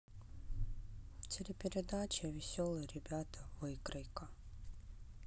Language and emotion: Russian, sad